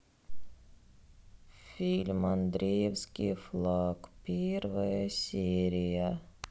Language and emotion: Russian, sad